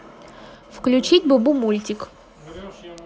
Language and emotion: Russian, neutral